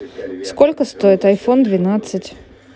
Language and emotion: Russian, neutral